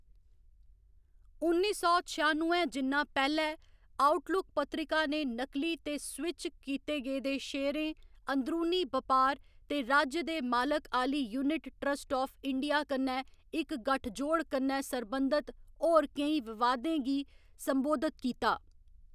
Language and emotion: Dogri, neutral